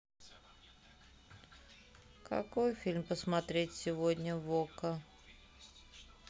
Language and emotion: Russian, sad